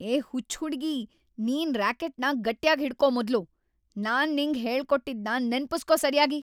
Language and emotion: Kannada, angry